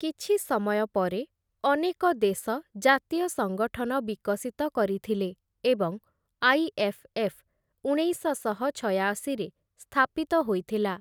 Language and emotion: Odia, neutral